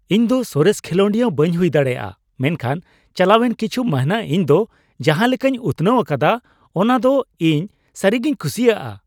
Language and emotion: Santali, happy